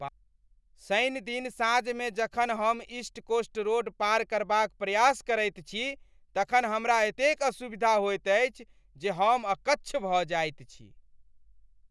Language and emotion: Maithili, angry